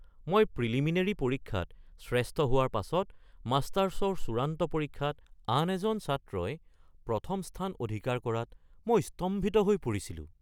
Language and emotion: Assamese, surprised